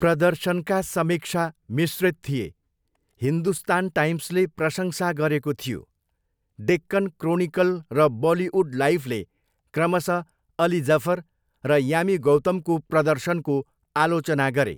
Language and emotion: Nepali, neutral